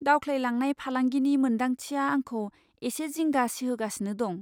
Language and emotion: Bodo, fearful